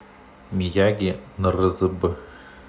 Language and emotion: Russian, neutral